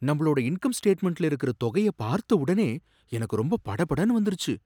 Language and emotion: Tamil, surprised